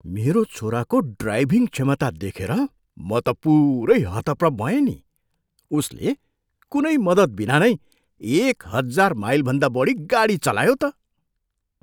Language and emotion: Nepali, surprised